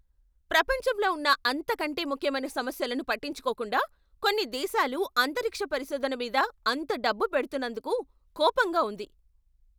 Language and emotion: Telugu, angry